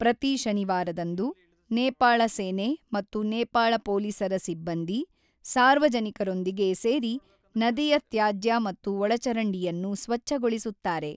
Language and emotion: Kannada, neutral